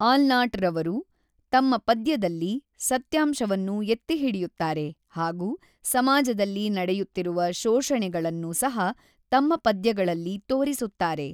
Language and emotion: Kannada, neutral